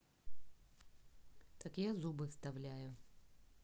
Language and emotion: Russian, neutral